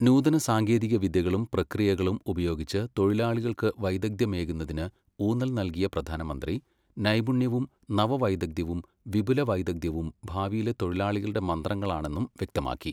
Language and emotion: Malayalam, neutral